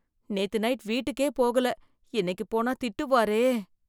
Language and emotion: Tamil, fearful